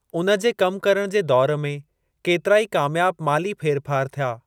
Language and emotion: Sindhi, neutral